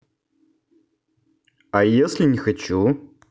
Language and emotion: Russian, neutral